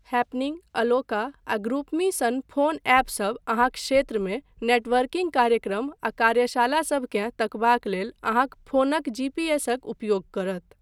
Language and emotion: Maithili, neutral